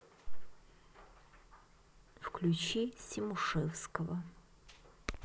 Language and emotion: Russian, neutral